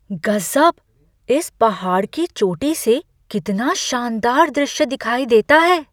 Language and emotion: Hindi, surprised